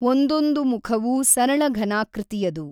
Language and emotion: Kannada, neutral